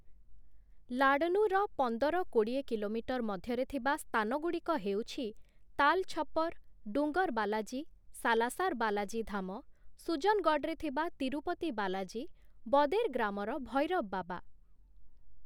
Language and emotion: Odia, neutral